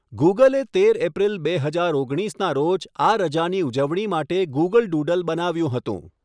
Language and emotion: Gujarati, neutral